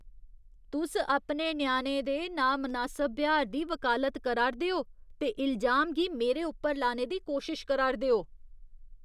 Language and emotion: Dogri, disgusted